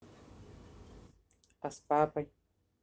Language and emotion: Russian, neutral